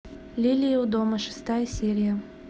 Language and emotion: Russian, neutral